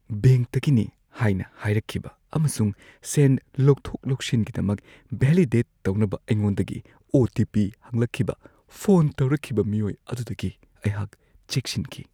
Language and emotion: Manipuri, fearful